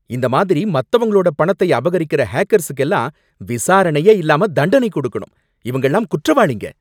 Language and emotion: Tamil, angry